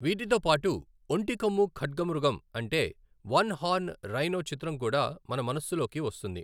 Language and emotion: Telugu, neutral